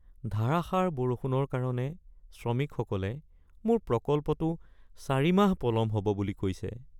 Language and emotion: Assamese, sad